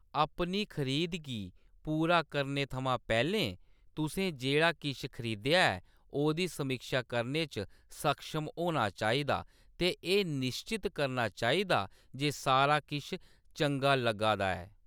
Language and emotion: Dogri, neutral